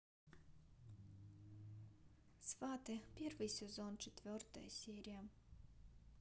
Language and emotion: Russian, neutral